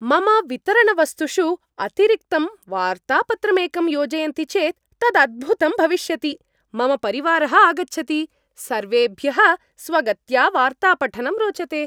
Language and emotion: Sanskrit, happy